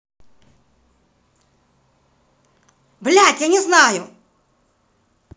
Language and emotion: Russian, angry